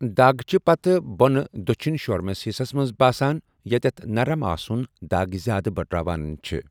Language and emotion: Kashmiri, neutral